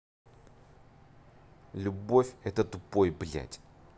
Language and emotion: Russian, angry